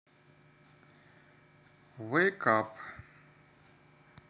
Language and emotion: Russian, neutral